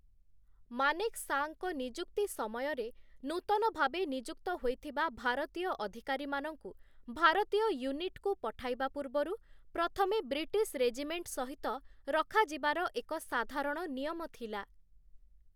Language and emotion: Odia, neutral